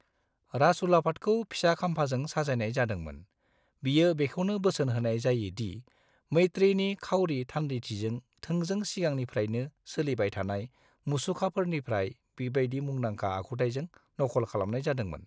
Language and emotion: Bodo, neutral